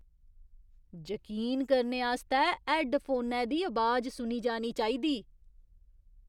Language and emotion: Dogri, surprised